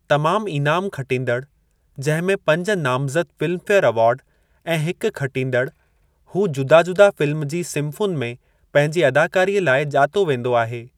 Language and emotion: Sindhi, neutral